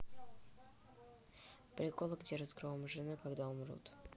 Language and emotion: Russian, neutral